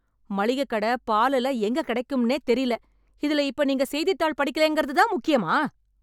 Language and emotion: Tamil, angry